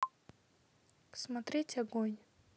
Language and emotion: Russian, neutral